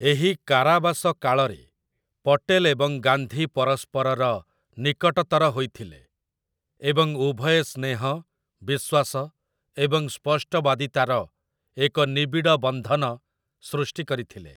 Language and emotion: Odia, neutral